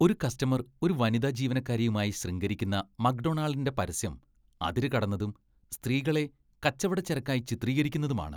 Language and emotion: Malayalam, disgusted